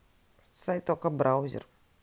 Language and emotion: Russian, neutral